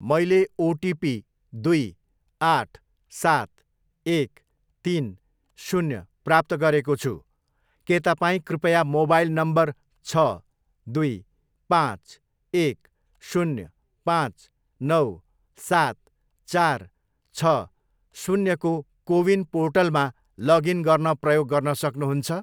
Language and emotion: Nepali, neutral